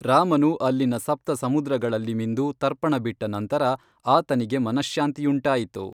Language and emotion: Kannada, neutral